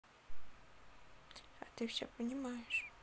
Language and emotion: Russian, neutral